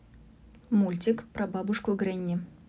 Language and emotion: Russian, neutral